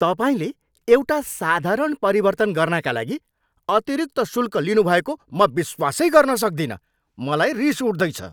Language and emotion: Nepali, angry